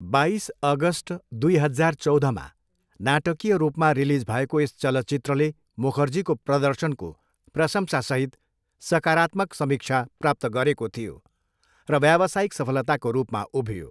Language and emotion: Nepali, neutral